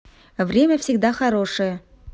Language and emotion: Russian, positive